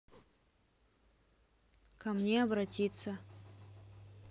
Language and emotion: Russian, neutral